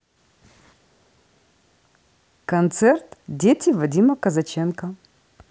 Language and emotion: Russian, neutral